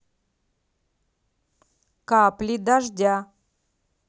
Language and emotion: Russian, neutral